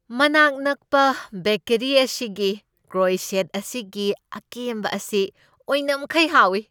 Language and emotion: Manipuri, happy